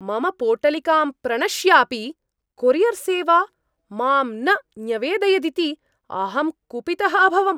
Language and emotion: Sanskrit, angry